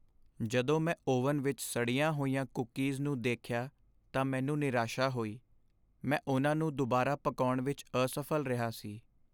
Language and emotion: Punjabi, sad